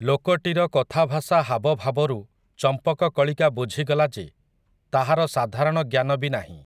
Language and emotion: Odia, neutral